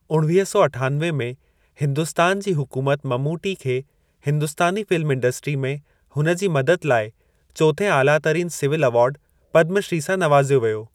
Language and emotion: Sindhi, neutral